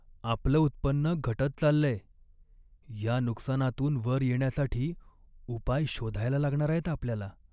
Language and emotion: Marathi, sad